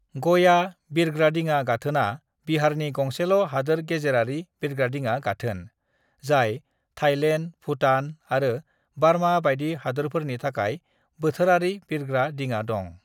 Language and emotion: Bodo, neutral